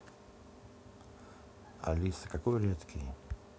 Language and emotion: Russian, neutral